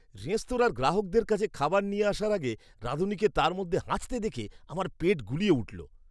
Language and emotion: Bengali, disgusted